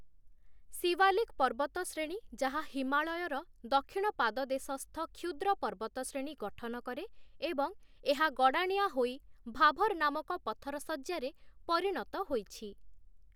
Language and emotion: Odia, neutral